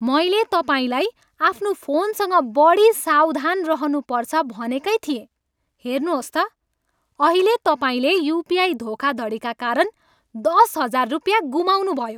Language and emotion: Nepali, angry